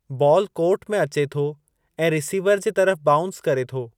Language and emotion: Sindhi, neutral